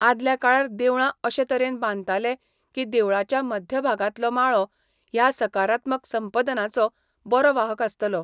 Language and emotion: Goan Konkani, neutral